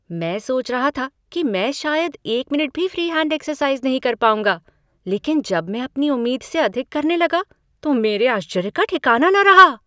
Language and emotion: Hindi, surprised